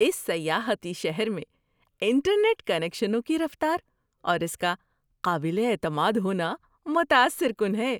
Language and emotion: Urdu, surprised